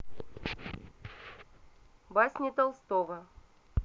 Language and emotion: Russian, neutral